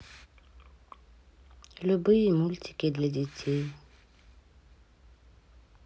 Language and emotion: Russian, neutral